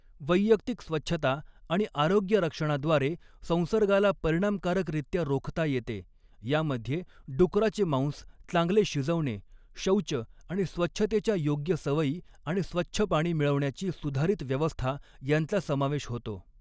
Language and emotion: Marathi, neutral